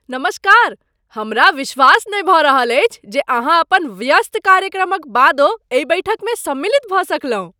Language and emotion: Maithili, surprised